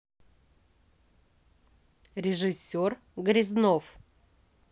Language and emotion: Russian, neutral